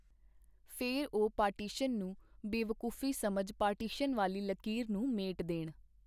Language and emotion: Punjabi, neutral